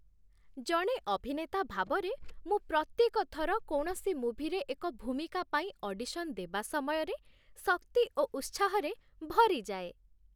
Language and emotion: Odia, happy